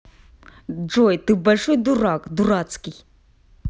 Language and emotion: Russian, angry